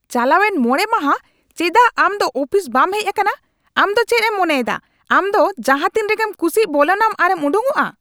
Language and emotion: Santali, angry